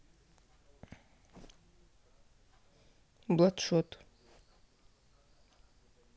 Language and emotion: Russian, neutral